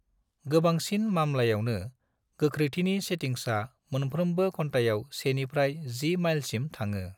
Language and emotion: Bodo, neutral